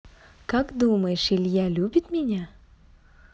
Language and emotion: Russian, positive